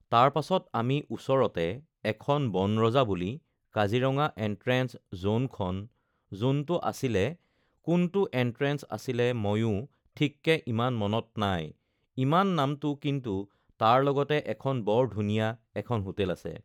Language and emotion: Assamese, neutral